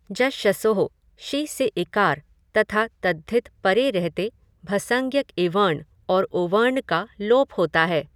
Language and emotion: Hindi, neutral